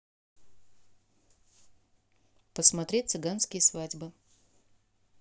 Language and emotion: Russian, neutral